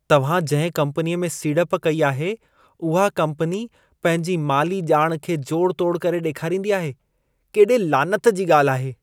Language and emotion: Sindhi, disgusted